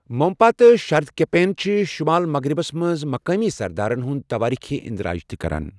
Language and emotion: Kashmiri, neutral